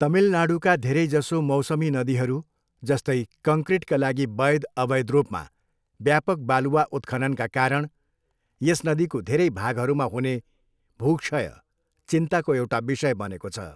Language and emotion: Nepali, neutral